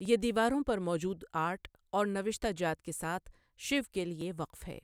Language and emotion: Urdu, neutral